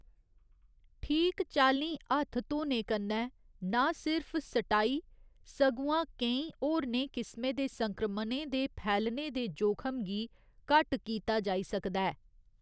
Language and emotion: Dogri, neutral